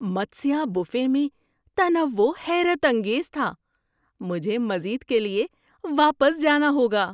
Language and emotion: Urdu, surprised